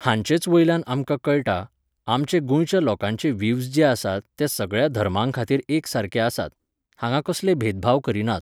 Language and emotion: Goan Konkani, neutral